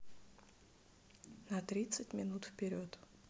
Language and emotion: Russian, neutral